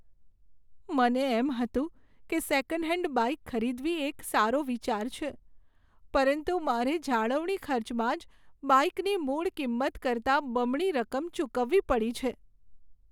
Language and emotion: Gujarati, sad